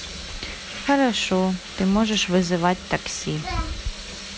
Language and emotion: Russian, positive